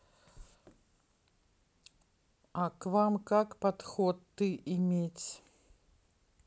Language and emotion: Russian, neutral